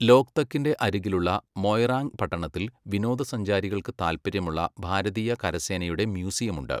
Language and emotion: Malayalam, neutral